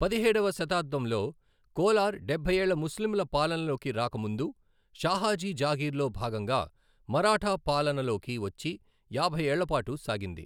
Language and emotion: Telugu, neutral